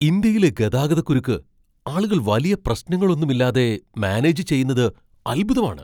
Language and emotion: Malayalam, surprised